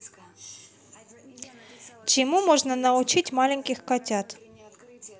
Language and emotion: Russian, neutral